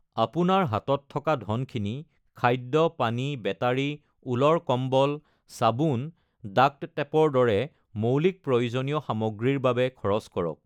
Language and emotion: Assamese, neutral